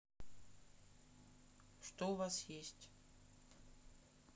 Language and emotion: Russian, neutral